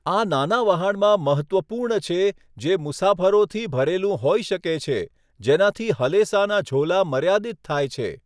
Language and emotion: Gujarati, neutral